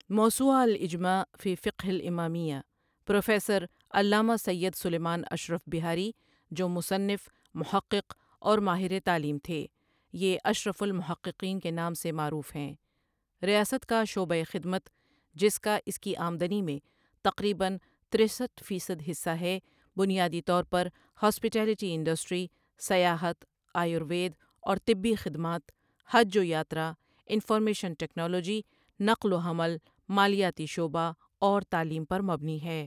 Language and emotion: Urdu, neutral